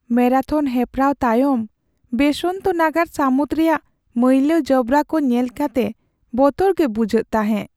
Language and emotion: Santali, sad